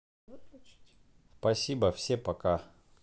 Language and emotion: Russian, neutral